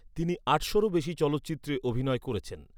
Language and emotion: Bengali, neutral